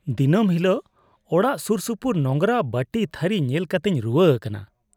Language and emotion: Santali, disgusted